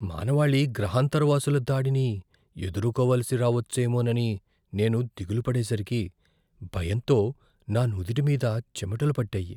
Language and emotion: Telugu, fearful